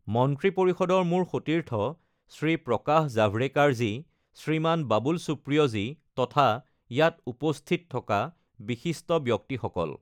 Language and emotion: Assamese, neutral